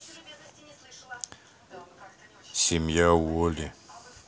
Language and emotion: Russian, neutral